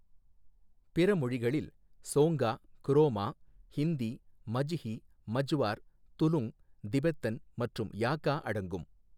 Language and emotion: Tamil, neutral